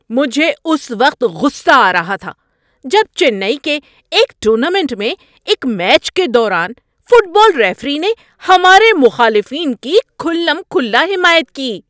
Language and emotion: Urdu, angry